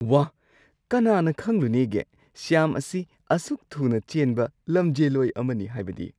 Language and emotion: Manipuri, surprised